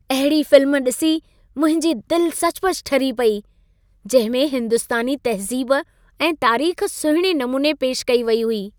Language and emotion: Sindhi, happy